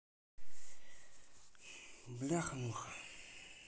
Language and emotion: Russian, neutral